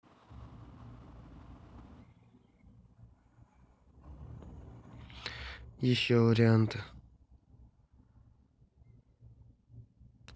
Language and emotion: Russian, neutral